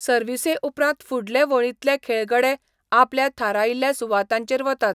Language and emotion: Goan Konkani, neutral